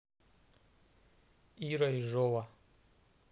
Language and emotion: Russian, neutral